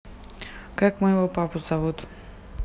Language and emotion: Russian, neutral